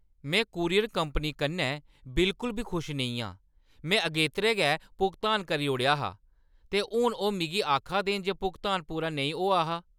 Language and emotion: Dogri, angry